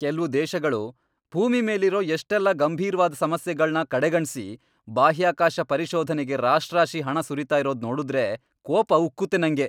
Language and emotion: Kannada, angry